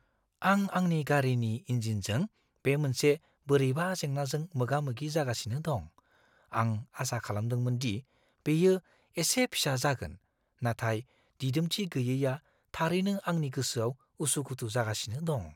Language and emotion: Bodo, fearful